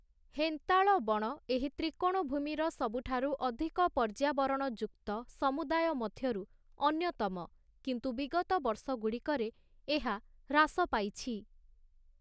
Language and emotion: Odia, neutral